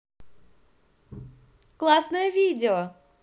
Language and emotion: Russian, positive